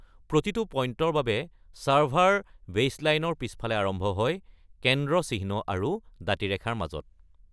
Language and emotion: Assamese, neutral